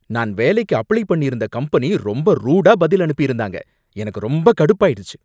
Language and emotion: Tamil, angry